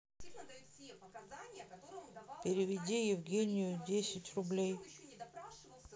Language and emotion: Russian, neutral